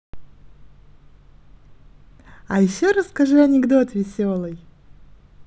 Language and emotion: Russian, positive